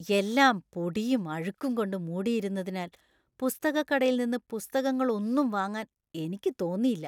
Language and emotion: Malayalam, disgusted